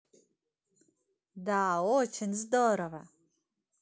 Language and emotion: Russian, positive